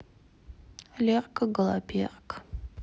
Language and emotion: Russian, sad